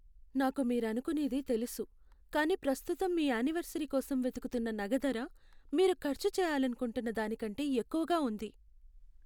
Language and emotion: Telugu, sad